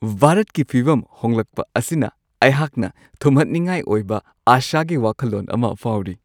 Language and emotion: Manipuri, happy